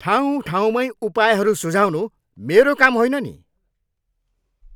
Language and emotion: Nepali, angry